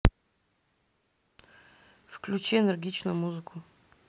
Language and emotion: Russian, neutral